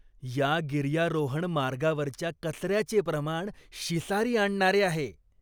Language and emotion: Marathi, disgusted